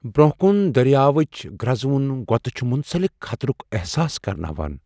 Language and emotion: Kashmiri, fearful